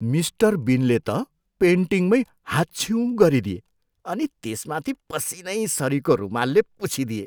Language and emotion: Nepali, disgusted